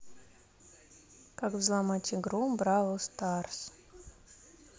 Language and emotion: Russian, neutral